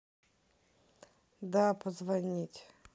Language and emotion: Russian, sad